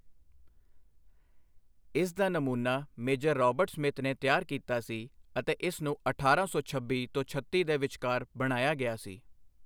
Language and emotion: Punjabi, neutral